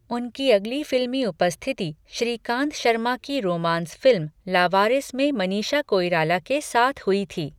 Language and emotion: Hindi, neutral